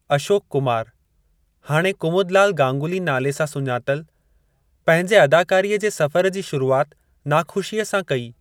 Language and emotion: Sindhi, neutral